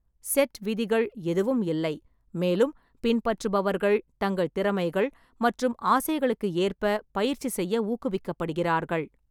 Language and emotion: Tamil, neutral